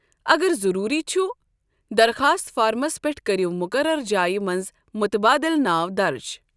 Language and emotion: Kashmiri, neutral